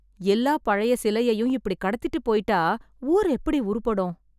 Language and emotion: Tamil, sad